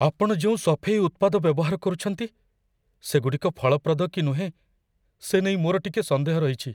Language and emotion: Odia, fearful